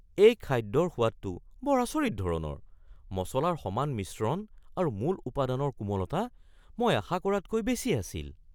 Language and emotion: Assamese, surprised